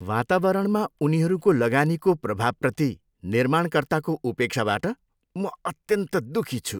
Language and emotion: Nepali, disgusted